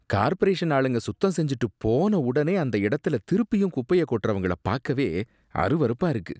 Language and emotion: Tamil, disgusted